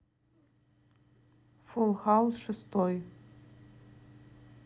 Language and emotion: Russian, neutral